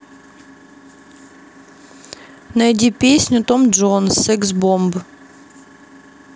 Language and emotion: Russian, neutral